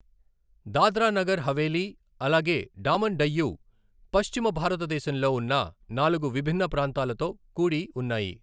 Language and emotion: Telugu, neutral